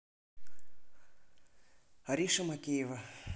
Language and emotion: Russian, neutral